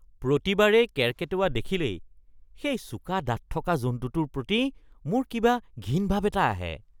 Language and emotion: Assamese, disgusted